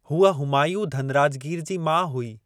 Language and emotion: Sindhi, neutral